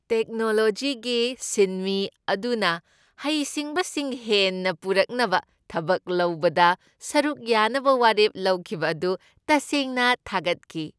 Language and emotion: Manipuri, happy